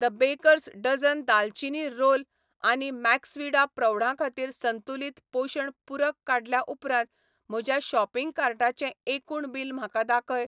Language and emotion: Goan Konkani, neutral